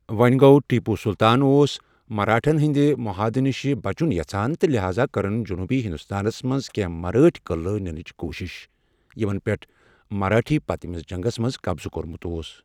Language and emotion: Kashmiri, neutral